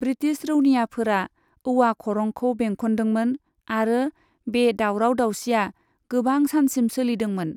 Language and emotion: Bodo, neutral